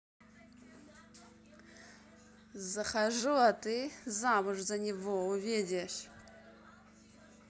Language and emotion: Russian, angry